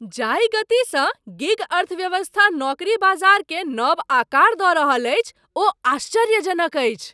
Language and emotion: Maithili, surprised